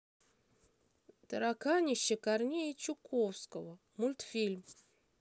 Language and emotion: Russian, neutral